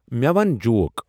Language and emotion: Kashmiri, neutral